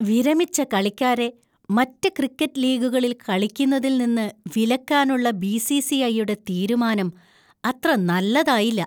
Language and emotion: Malayalam, disgusted